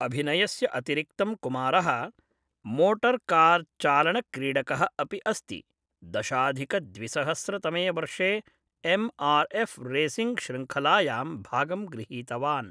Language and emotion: Sanskrit, neutral